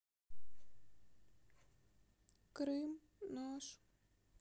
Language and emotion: Russian, sad